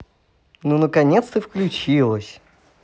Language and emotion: Russian, positive